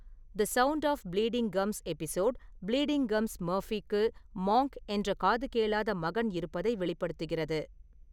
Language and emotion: Tamil, neutral